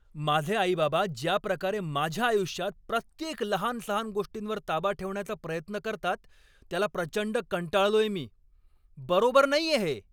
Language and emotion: Marathi, angry